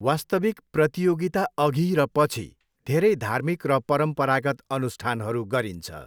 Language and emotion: Nepali, neutral